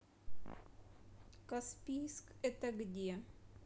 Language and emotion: Russian, neutral